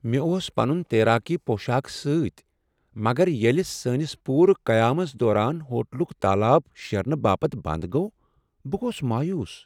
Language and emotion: Kashmiri, sad